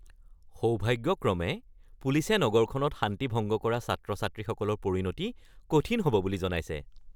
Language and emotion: Assamese, happy